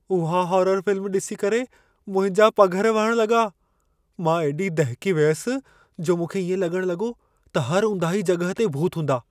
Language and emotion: Sindhi, fearful